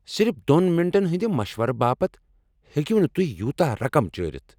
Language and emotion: Kashmiri, angry